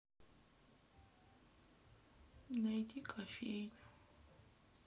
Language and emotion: Russian, sad